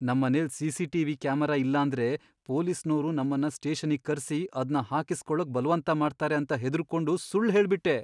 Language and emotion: Kannada, fearful